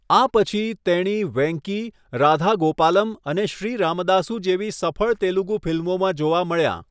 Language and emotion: Gujarati, neutral